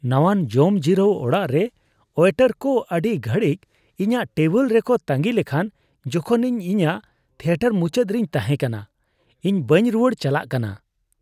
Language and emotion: Santali, disgusted